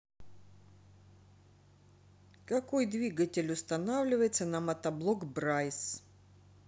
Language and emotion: Russian, neutral